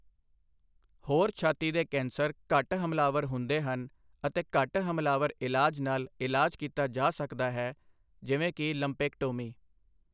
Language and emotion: Punjabi, neutral